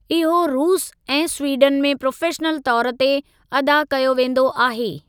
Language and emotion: Sindhi, neutral